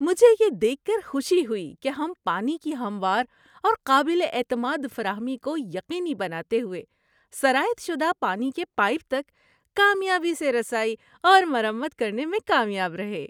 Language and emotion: Urdu, happy